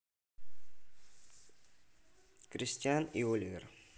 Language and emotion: Russian, neutral